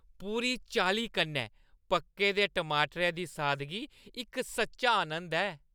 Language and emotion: Dogri, happy